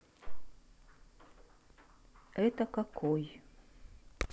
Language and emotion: Russian, neutral